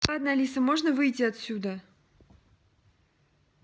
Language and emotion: Russian, angry